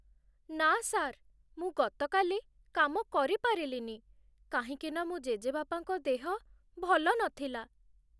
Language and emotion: Odia, sad